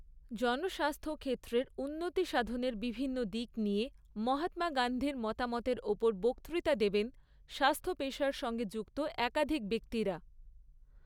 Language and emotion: Bengali, neutral